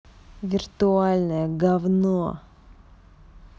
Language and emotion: Russian, angry